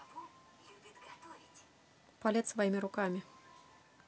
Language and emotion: Russian, neutral